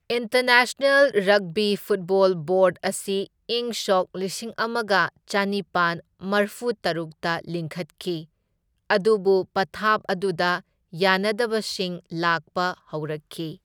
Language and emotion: Manipuri, neutral